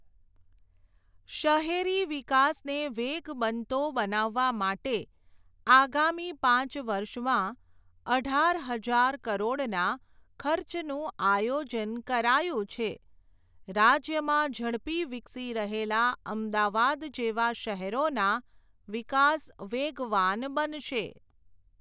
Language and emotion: Gujarati, neutral